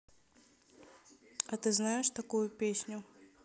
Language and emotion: Russian, neutral